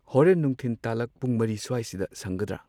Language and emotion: Manipuri, neutral